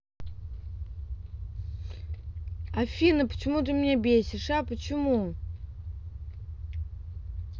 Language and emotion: Russian, angry